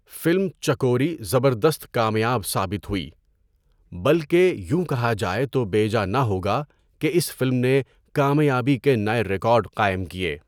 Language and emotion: Urdu, neutral